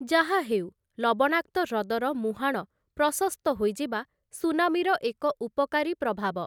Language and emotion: Odia, neutral